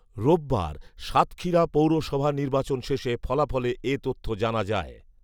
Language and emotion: Bengali, neutral